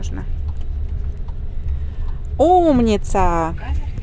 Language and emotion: Russian, positive